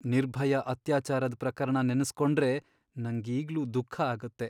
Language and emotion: Kannada, sad